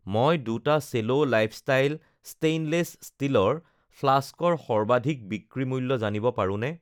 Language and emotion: Assamese, neutral